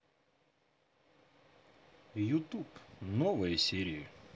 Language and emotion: Russian, positive